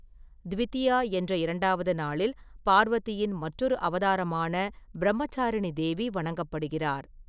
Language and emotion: Tamil, neutral